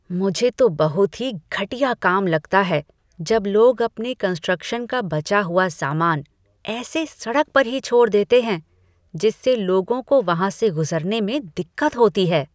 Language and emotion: Hindi, disgusted